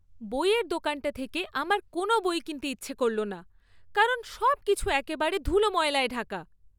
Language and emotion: Bengali, disgusted